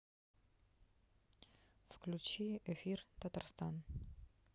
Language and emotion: Russian, neutral